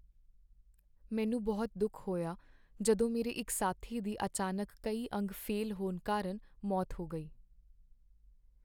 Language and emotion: Punjabi, sad